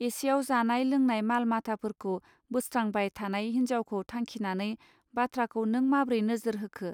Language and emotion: Bodo, neutral